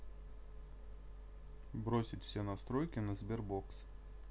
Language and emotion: Russian, neutral